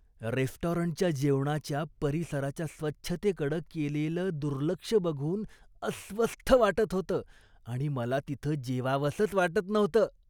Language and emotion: Marathi, disgusted